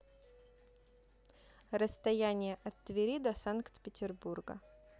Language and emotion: Russian, neutral